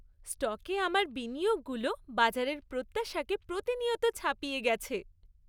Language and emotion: Bengali, happy